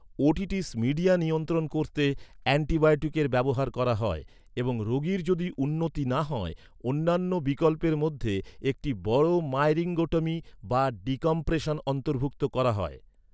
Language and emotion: Bengali, neutral